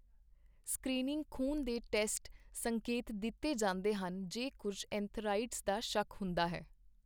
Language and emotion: Punjabi, neutral